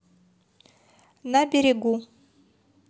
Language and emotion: Russian, neutral